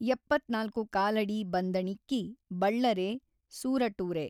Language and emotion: Kannada, neutral